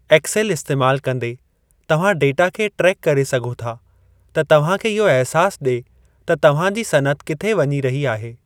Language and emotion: Sindhi, neutral